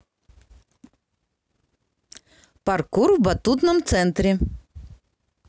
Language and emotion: Russian, positive